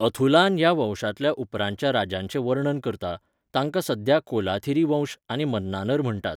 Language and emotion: Goan Konkani, neutral